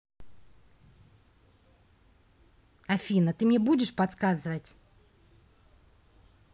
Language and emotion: Russian, angry